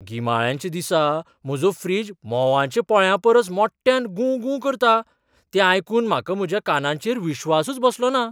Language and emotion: Goan Konkani, surprised